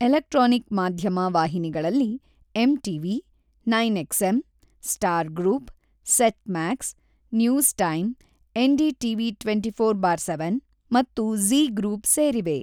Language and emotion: Kannada, neutral